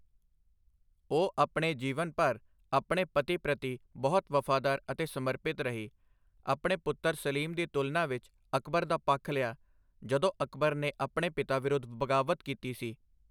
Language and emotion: Punjabi, neutral